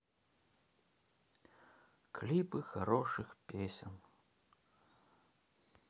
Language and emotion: Russian, sad